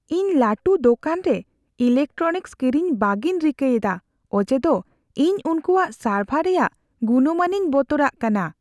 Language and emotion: Santali, fearful